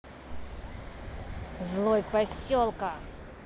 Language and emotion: Russian, angry